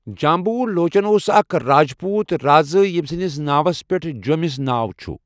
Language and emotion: Kashmiri, neutral